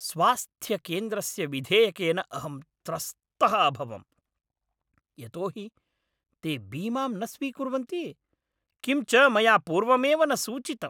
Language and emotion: Sanskrit, angry